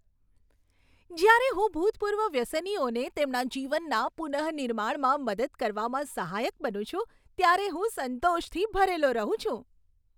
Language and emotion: Gujarati, happy